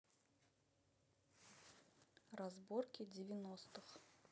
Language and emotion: Russian, neutral